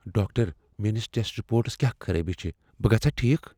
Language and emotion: Kashmiri, fearful